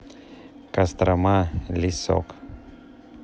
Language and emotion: Russian, neutral